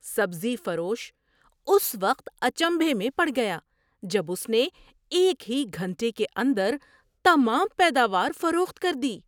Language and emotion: Urdu, surprised